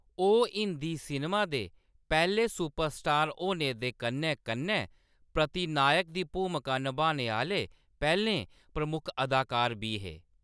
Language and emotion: Dogri, neutral